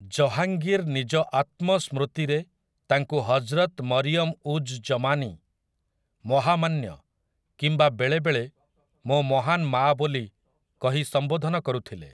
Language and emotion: Odia, neutral